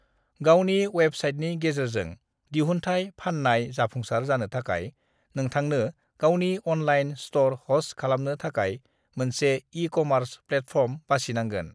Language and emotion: Bodo, neutral